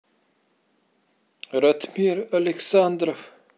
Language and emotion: Russian, neutral